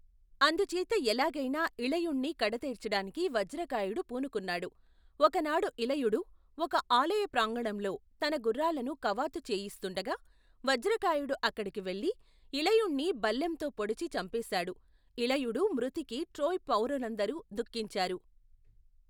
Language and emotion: Telugu, neutral